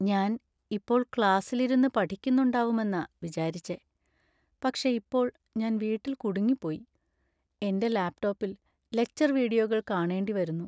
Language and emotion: Malayalam, sad